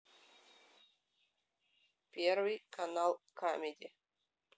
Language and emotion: Russian, neutral